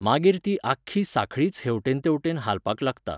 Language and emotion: Goan Konkani, neutral